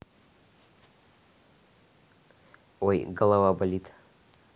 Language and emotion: Russian, neutral